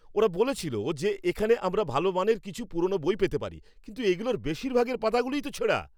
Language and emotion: Bengali, angry